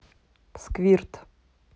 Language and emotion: Russian, neutral